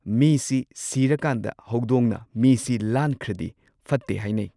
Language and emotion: Manipuri, neutral